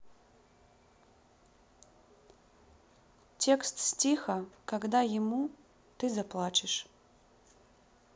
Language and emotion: Russian, sad